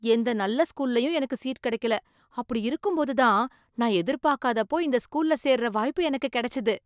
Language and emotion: Tamil, surprised